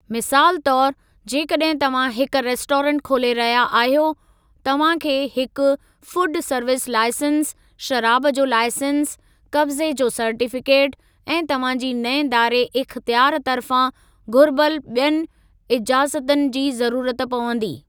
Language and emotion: Sindhi, neutral